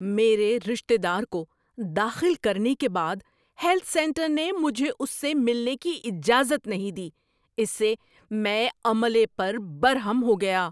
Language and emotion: Urdu, angry